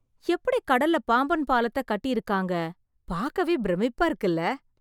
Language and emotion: Tamil, surprised